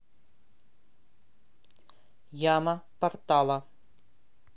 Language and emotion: Russian, neutral